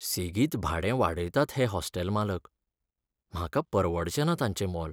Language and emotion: Goan Konkani, sad